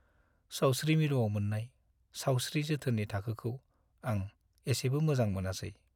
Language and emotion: Bodo, sad